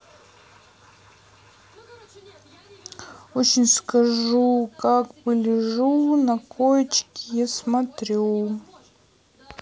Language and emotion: Russian, neutral